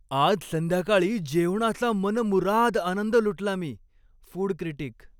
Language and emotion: Marathi, happy